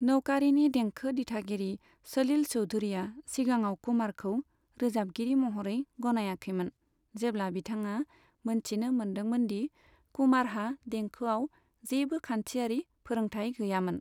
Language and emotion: Bodo, neutral